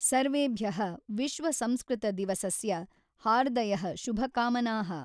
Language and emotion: Kannada, neutral